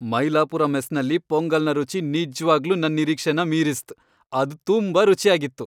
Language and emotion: Kannada, happy